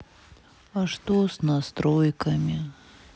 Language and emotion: Russian, sad